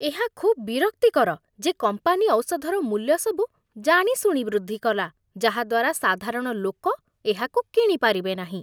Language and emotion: Odia, disgusted